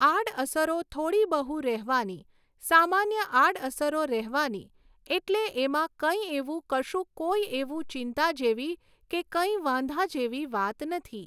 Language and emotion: Gujarati, neutral